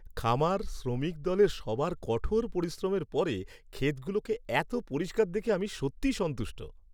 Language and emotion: Bengali, happy